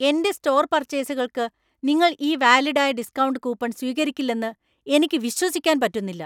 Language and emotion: Malayalam, angry